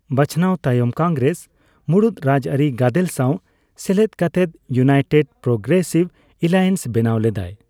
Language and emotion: Santali, neutral